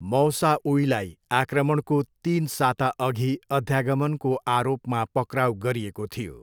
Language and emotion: Nepali, neutral